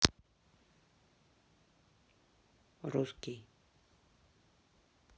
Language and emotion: Russian, sad